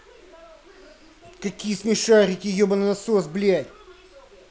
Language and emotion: Russian, angry